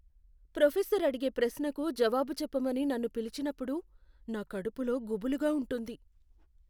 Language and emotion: Telugu, fearful